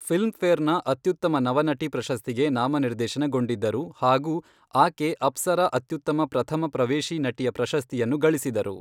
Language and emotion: Kannada, neutral